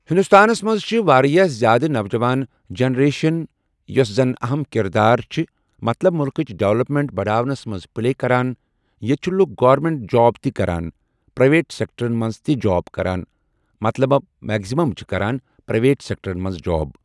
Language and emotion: Kashmiri, neutral